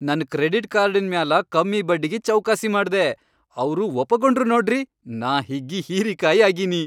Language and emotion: Kannada, happy